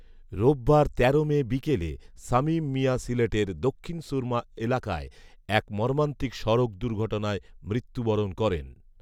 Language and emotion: Bengali, neutral